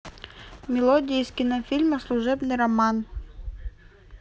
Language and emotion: Russian, neutral